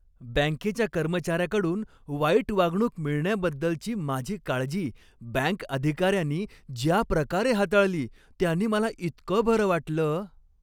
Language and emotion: Marathi, happy